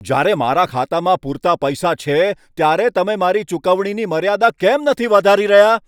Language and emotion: Gujarati, angry